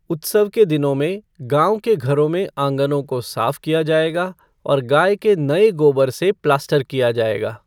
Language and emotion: Hindi, neutral